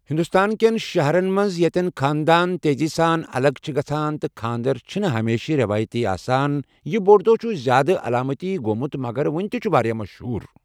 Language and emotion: Kashmiri, neutral